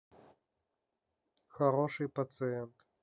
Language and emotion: Russian, neutral